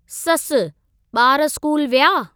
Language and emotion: Sindhi, neutral